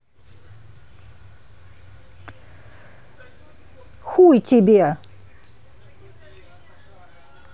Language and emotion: Russian, angry